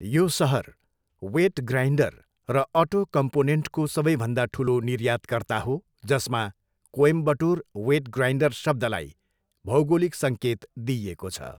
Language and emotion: Nepali, neutral